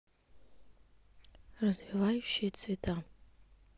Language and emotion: Russian, neutral